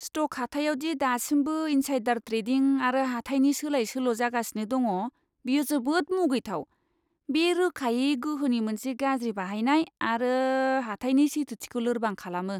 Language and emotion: Bodo, disgusted